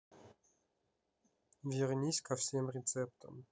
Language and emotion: Russian, neutral